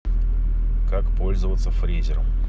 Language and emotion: Russian, neutral